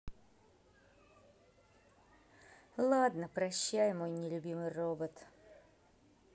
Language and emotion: Russian, sad